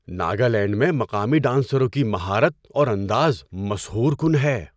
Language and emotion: Urdu, surprised